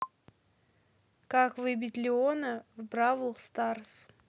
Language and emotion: Russian, neutral